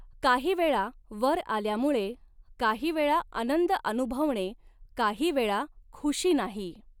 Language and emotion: Marathi, neutral